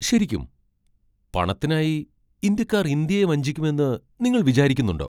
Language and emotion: Malayalam, surprised